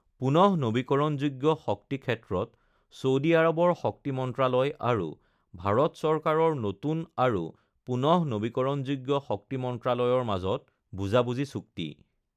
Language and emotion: Assamese, neutral